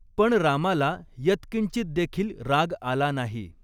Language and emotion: Marathi, neutral